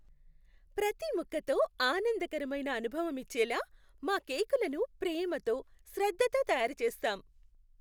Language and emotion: Telugu, happy